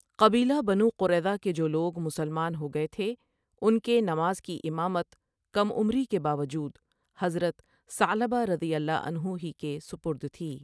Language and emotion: Urdu, neutral